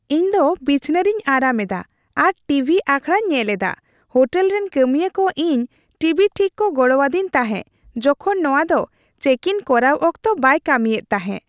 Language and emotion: Santali, happy